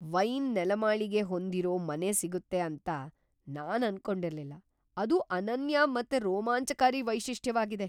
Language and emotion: Kannada, surprised